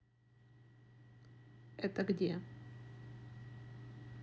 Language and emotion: Russian, neutral